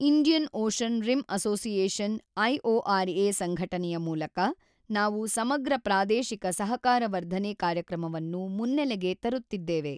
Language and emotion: Kannada, neutral